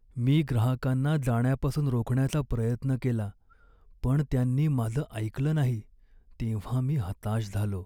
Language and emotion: Marathi, sad